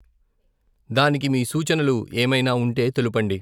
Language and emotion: Telugu, neutral